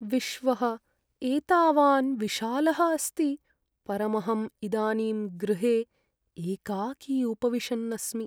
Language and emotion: Sanskrit, sad